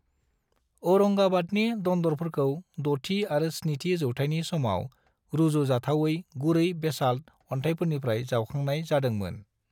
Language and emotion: Bodo, neutral